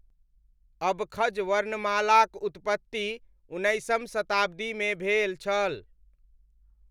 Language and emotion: Maithili, neutral